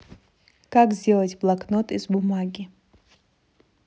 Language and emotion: Russian, neutral